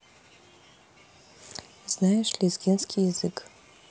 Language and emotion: Russian, neutral